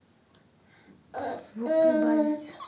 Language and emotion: Russian, neutral